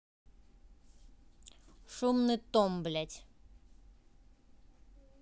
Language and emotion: Russian, neutral